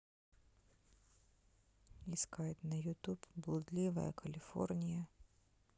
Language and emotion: Russian, neutral